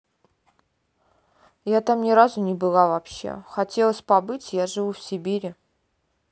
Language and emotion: Russian, neutral